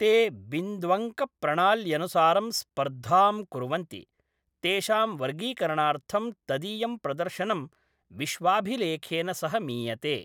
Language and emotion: Sanskrit, neutral